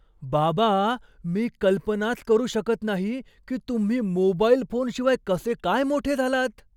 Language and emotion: Marathi, surprised